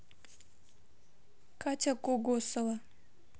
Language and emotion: Russian, neutral